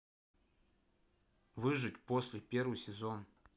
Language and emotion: Russian, neutral